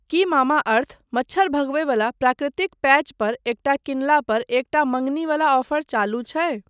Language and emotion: Maithili, neutral